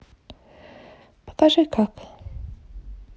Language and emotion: Russian, sad